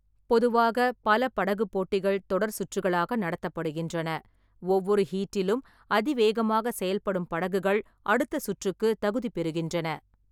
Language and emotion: Tamil, neutral